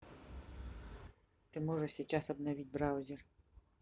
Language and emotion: Russian, neutral